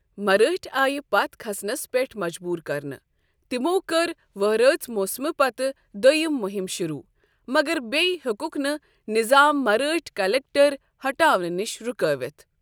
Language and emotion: Kashmiri, neutral